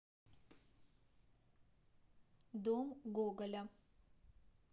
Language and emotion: Russian, neutral